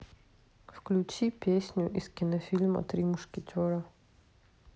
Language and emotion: Russian, neutral